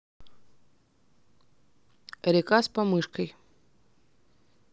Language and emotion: Russian, neutral